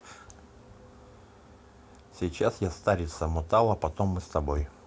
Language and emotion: Russian, neutral